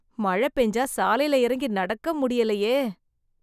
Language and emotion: Tamil, disgusted